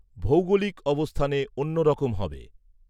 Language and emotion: Bengali, neutral